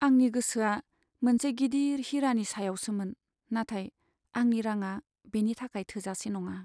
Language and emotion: Bodo, sad